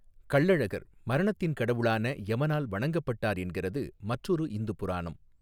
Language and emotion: Tamil, neutral